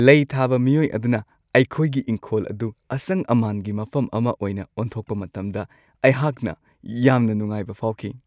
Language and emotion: Manipuri, happy